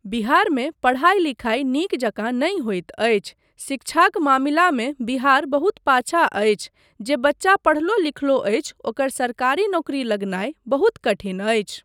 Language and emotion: Maithili, neutral